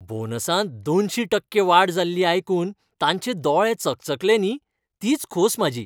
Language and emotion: Goan Konkani, happy